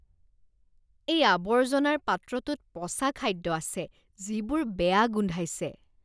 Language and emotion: Assamese, disgusted